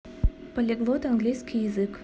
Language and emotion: Russian, neutral